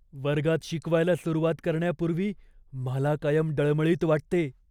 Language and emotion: Marathi, fearful